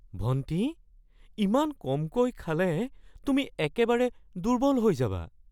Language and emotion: Assamese, fearful